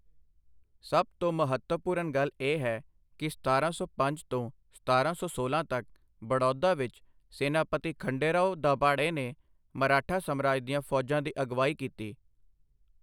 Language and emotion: Punjabi, neutral